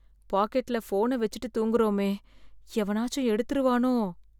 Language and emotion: Tamil, fearful